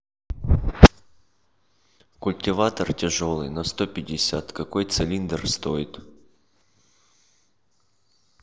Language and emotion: Russian, neutral